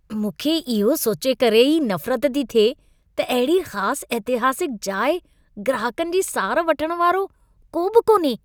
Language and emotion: Sindhi, disgusted